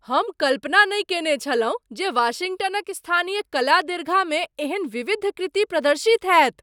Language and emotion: Maithili, surprised